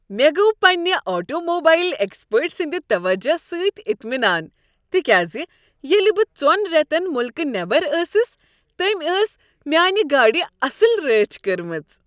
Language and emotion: Kashmiri, happy